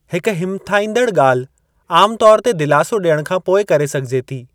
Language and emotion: Sindhi, neutral